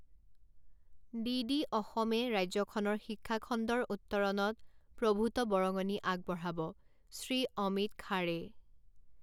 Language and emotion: Assamese, neutral